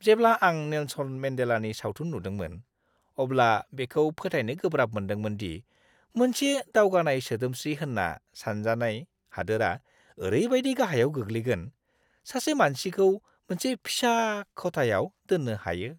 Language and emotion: Bodo, disgusted